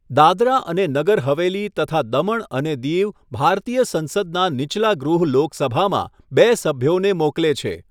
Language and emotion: Gujarati, neutral